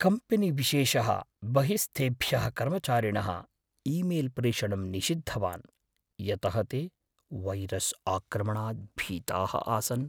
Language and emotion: Sanskrit, fearful